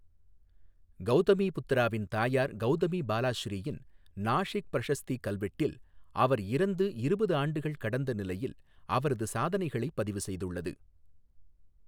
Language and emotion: Tamil, neutral